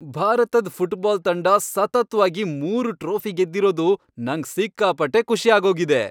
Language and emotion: Kannada, happy